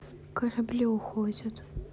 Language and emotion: Russian, sad